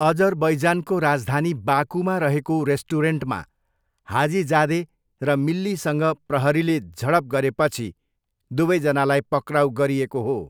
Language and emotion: Nepali, neutral